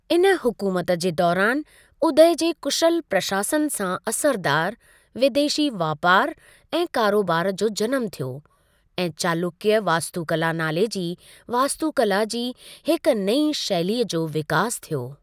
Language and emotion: Sindhi, neutral